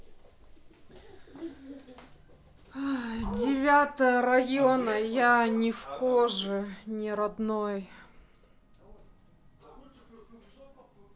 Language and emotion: Russian, sad